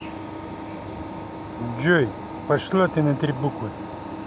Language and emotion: Russian, angry